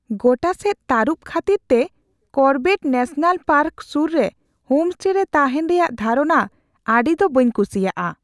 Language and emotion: Santali, fearful